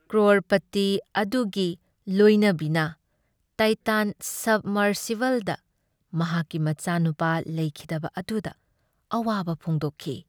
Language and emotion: Manipuri, sad